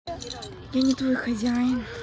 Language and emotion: Russian, neutral